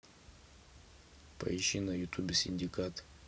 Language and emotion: Russian, neutral